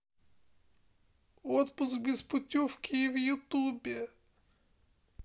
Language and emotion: Russian, sad